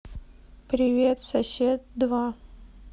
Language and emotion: Russian, neutral